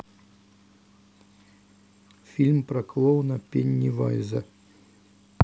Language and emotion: Russian, neutral